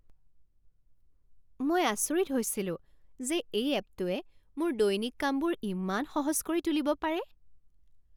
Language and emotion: Assamese, surprised